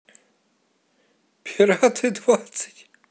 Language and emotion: Russian, positive